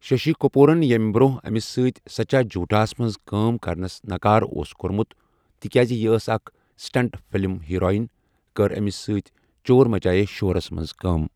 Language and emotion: Kashmiri, neutral